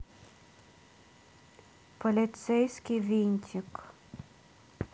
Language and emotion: Russian, neutral